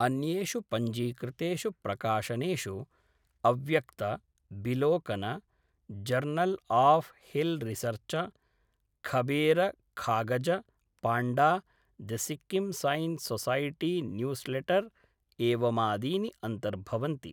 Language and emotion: Sanskrit, neutral